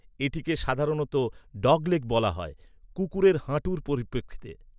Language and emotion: Bengali, neutral